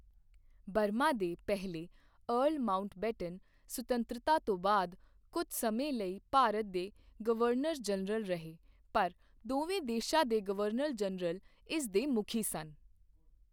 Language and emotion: Punjabi, neutral